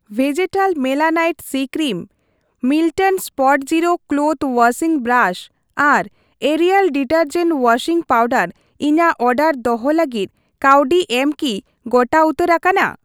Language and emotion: Santali, neutral